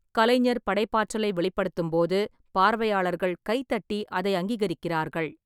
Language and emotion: Tamil, neutral